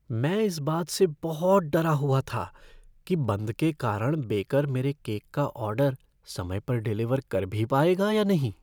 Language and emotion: Hindi, fearful